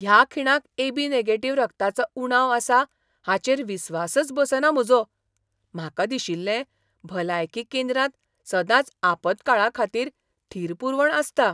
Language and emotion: Goan Konkani, surprised